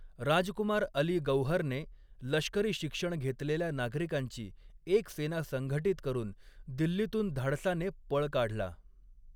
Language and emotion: Marathi, neutral